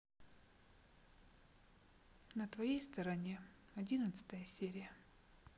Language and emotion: Russian, sad